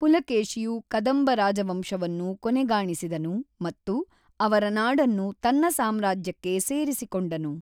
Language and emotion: Kannada, neutral